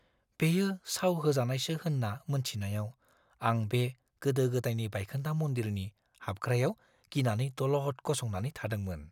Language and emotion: Bodo, fearful